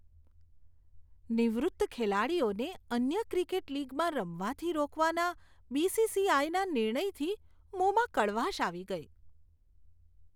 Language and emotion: Gujarati, disgusted